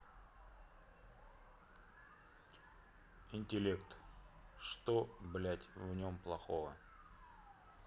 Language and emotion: Russian, neutral